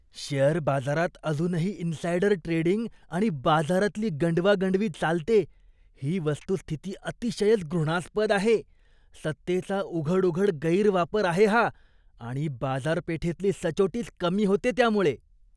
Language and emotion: Marathi, disgusted